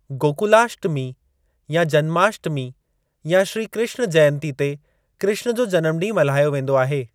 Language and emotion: Sindhi, neutral